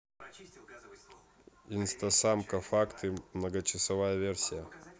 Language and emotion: Russian, neutral